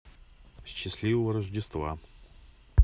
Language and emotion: Russian, neutral